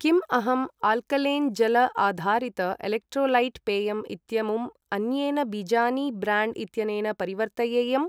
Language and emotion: Sanskrit, neutral